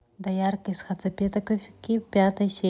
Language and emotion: Russian, neutral